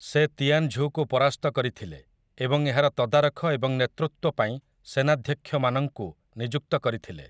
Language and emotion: Odia, neutral